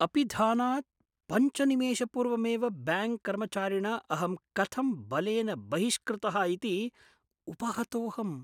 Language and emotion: Sanskrit, surprised